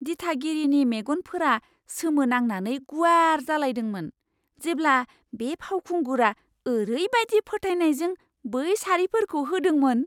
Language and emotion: Bodo, surprised